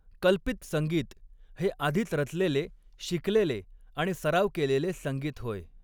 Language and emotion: Marathi, neutral